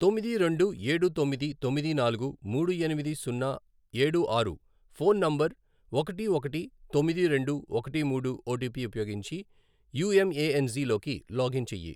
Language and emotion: Telugu, neutral